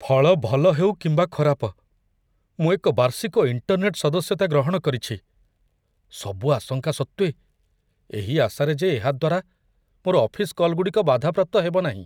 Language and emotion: Odia, fearful